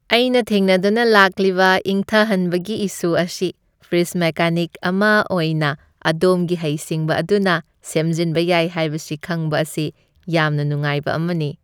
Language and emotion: Manipuri, happy